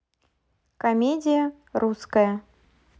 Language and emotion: Russian, neutral